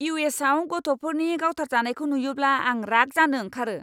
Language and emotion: Bodo, angry